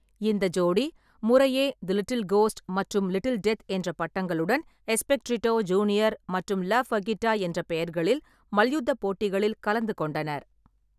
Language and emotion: Tamil, neutral